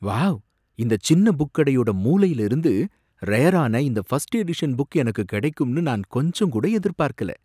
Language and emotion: Tamil, surprised